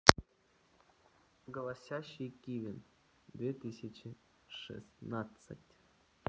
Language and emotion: Russian, neutral